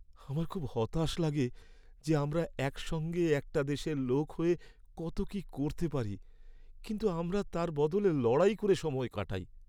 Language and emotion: Bengali, sad